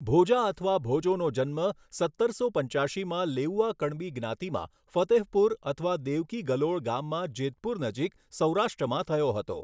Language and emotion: Gujarati, neutral